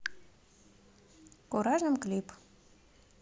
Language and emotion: Russian, neutral